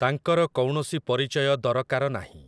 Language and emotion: Odia, neutral